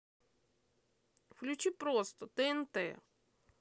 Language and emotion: Russian, angry